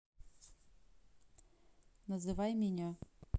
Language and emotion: Russian, neutral